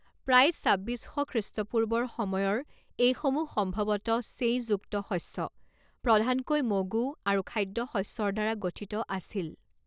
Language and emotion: Assamese, neutral